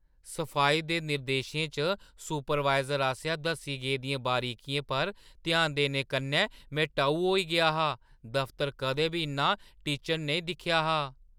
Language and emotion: Dogri, surprised